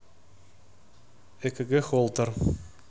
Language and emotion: Russian, neutral